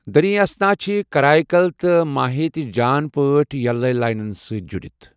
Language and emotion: Kashmiri, neutral